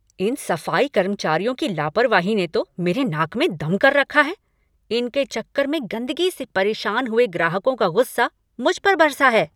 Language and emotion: Hindi, angry